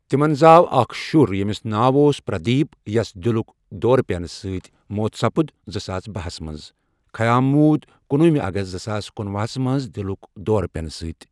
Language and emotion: Kashmiri, neutral